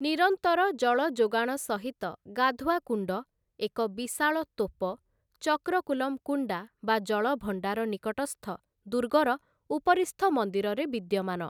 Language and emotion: Odia, neutral